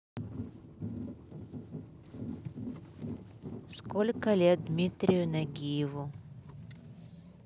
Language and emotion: Russian, neutral